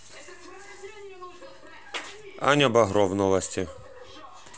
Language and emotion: Russian, neutral